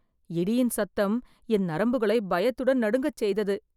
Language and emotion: Tamil, fearful